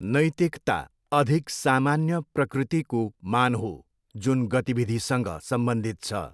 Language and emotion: Nepali, neutral